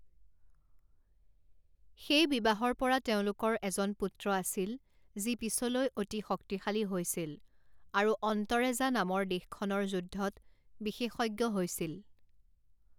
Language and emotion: Assamese, neutral